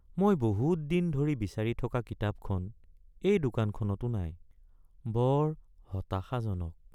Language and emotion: Assamese, sad